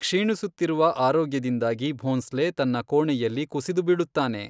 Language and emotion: Kannada, neutral